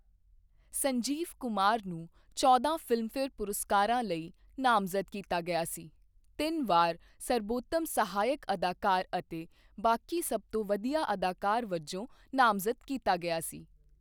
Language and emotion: Punjabi, neutral